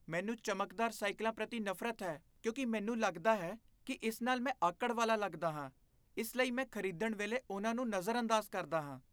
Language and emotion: Punjabi, disgusted